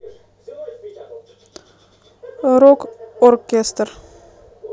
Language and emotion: Russian, neutral